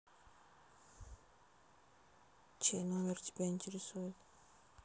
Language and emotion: Russian, neutral